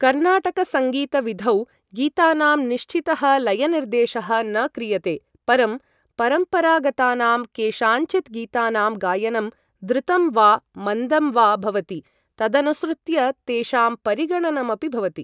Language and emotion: Sanskrit, neutral